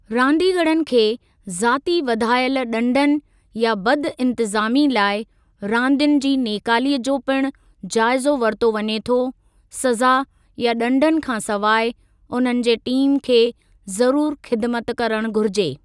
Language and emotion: Sindhi, neutral